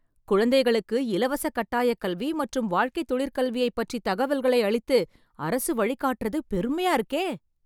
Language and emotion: Tamil, surprised